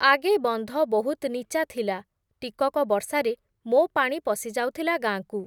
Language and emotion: Odia, neutral